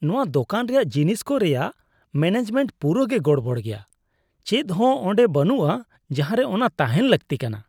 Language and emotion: Santali, disgusted